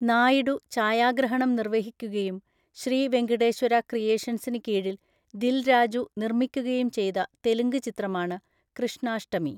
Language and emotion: Malayalam, neutral